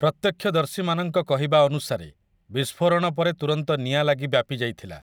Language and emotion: Odia, neutral